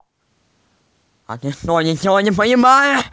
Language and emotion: Russian, angry